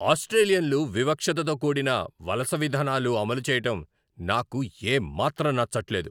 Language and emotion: Telugu, angry